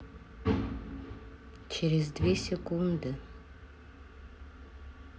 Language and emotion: Russian, neutral